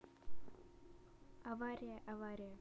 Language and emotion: Russian, neutral